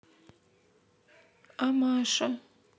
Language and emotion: Russian, sad